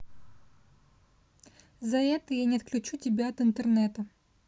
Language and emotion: Russian, neutral